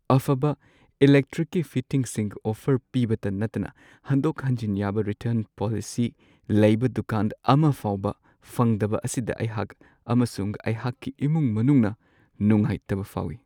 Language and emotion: Manipuri, sad